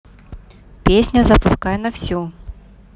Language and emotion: Russian, neutral